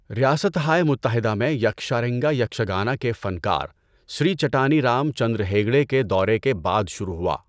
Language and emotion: Urdu, neutral